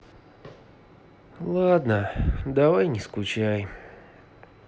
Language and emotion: Russian, sad